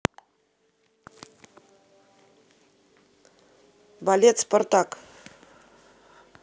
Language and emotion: Russian, neutral